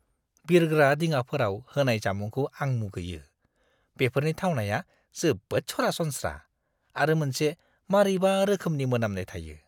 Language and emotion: Bodo, disgusted